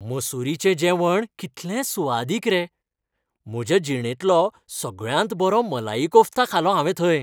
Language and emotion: Goan Konkani, happy